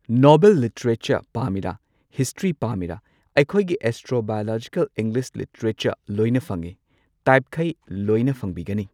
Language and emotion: Manipuri, neutral